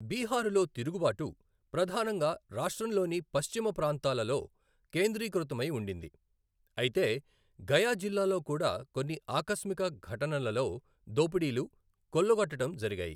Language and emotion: Telugu, neutral